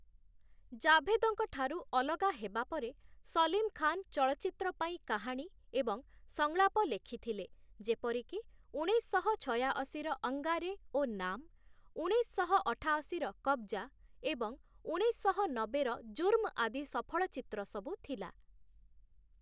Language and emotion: Odia, neutral